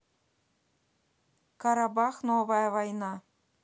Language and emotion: Russian, neutral